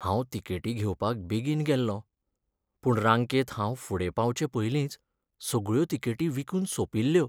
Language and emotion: Goan Konkani, sad